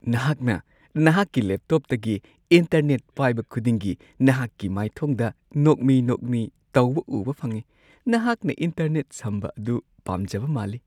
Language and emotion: Manipuri, happy